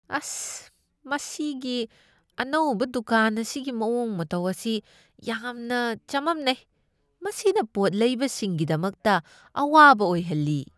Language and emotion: Manipuri, disgusted